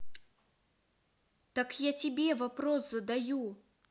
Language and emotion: Russian, angry